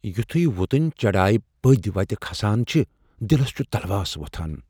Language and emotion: Kashmiri, fearful